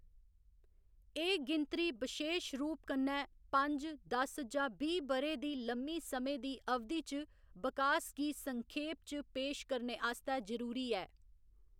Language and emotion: Dogri, neutral